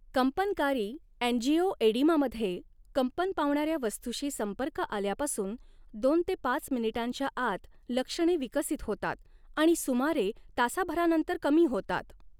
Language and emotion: Marathi, neutral